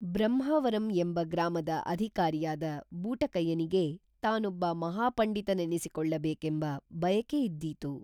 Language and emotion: Kannada, neutral